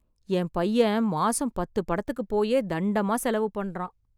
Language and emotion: Tamil, sad